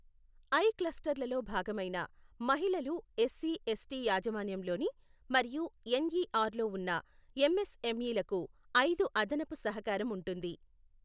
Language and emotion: Telugu, neutral